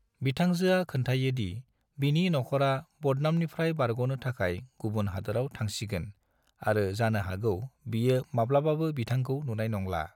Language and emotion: Bodo, neutral